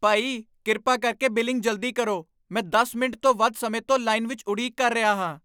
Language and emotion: Punjabi, angry